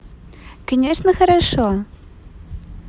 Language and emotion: Russian, positive